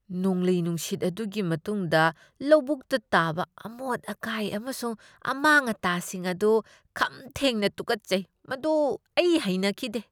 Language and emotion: Manipuri, disgusted